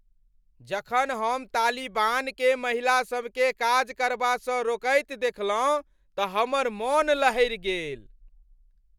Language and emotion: Maithili, angry